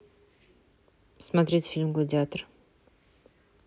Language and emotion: Russian, neutral